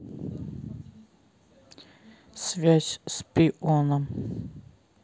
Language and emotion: Russian, neutral